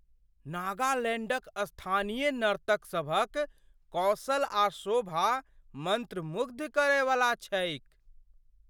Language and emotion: Maithili, surprised